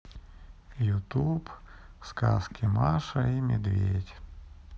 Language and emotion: Russian, sad